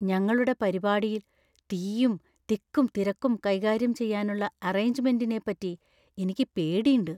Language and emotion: Malayalam, fearful